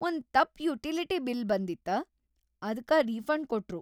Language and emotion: Kannada, happy